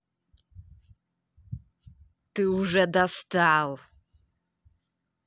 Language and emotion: Russian, angry